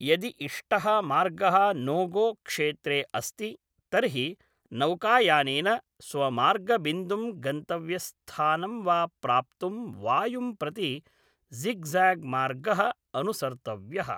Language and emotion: Sanskrit, neutral